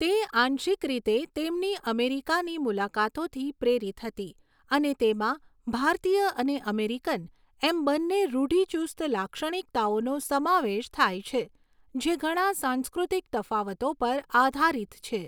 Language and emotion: Gujarati, neutral